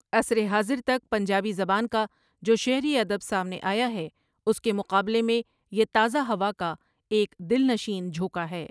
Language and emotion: Urdu, neutral